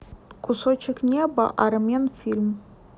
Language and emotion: Russian, neutral